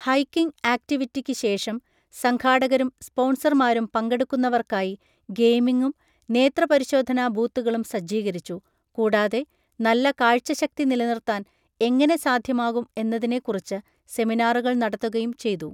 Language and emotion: Malayalam, neutral